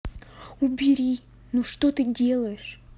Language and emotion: Russian, angry